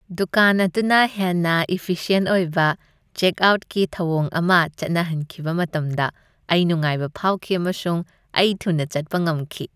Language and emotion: Manipuri, happy